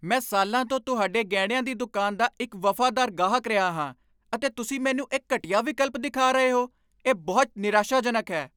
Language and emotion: Punjabi, angry